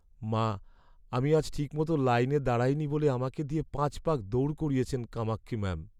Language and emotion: Bengali, sad